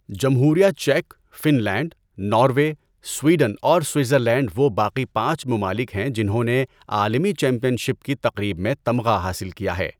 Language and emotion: Urdu, neutral